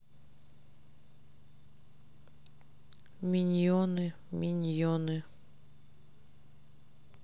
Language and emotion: Russian, sad